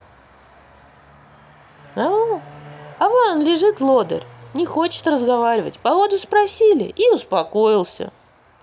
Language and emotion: Russian, positive